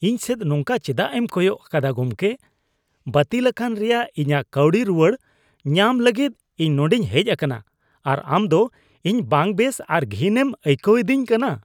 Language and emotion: Santali, disgusted